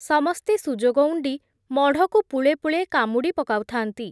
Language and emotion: Odia, neutral